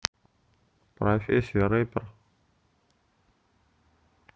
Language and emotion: Russian, neutral